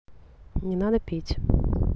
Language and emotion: Russian, neutral